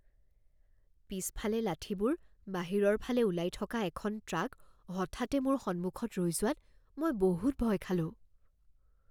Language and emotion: Assamese, fearful